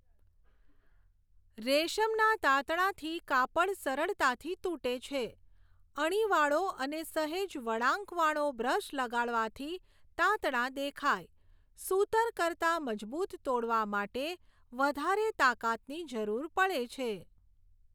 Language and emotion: Gujarati, neutral